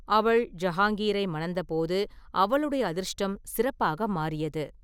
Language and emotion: Tamil, neutral